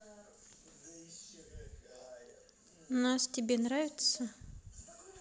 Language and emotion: Russian, neutral